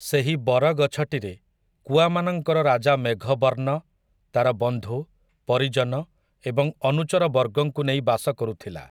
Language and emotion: Odia, neutral